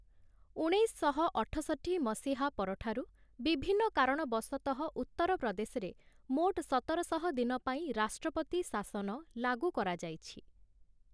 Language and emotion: Odia, neutral